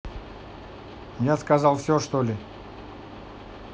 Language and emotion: Russian, neutral